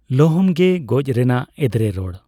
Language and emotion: Santali, neutral